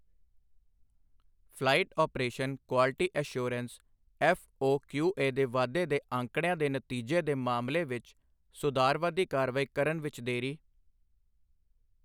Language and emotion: Punjabi, neutral